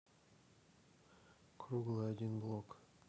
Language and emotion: Russian, neutral